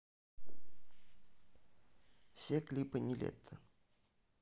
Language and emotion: Russian, neutral